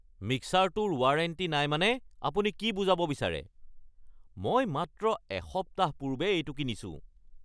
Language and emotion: Assamese, angry